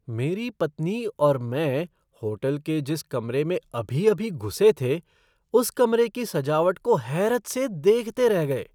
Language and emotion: Hindi, surprised